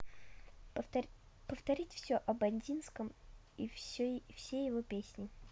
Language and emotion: Russian, neutral